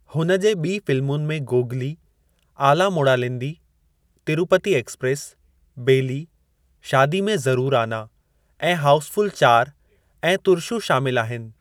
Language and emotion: Sindhi, neutral